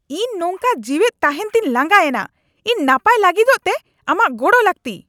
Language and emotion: Santali, angry